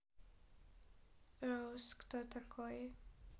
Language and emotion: Russian, neutral